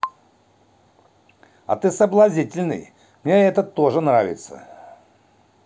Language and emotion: Russian, positive